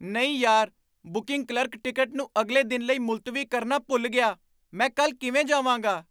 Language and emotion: Punjabi, surprised